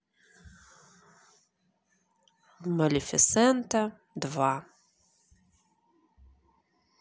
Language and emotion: Russian, neutral